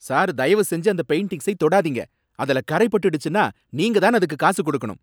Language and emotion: Tamil, angry